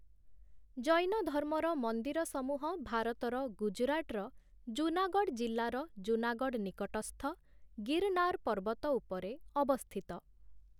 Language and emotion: Odia, neutral